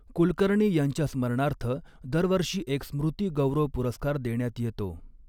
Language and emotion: Marathi, neutral